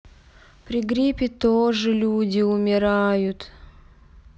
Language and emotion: Russian, sad